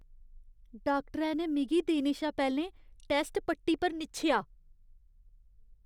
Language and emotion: Dogri, disgusted